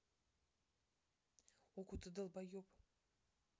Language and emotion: Russian, angry